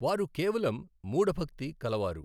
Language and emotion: Telugu, neutral